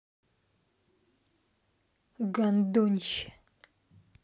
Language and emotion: Russian, angry